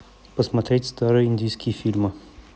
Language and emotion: Russian, neutral